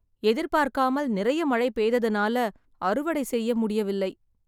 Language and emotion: Tamil, sad